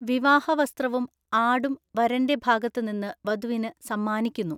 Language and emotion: Malayalam, neutral